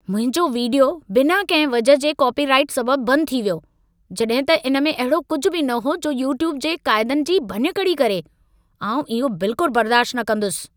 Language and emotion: Sindhi, angry